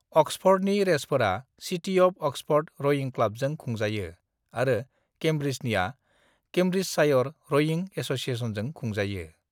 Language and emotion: Bodo, neutral